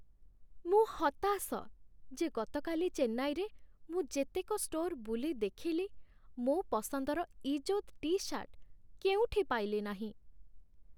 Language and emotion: Odia, sad